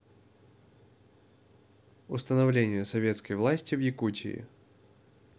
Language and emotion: Russian, neutral